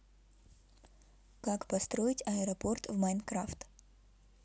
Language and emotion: Russian, neutral